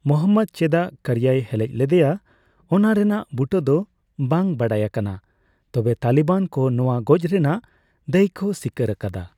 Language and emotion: Santali, neutral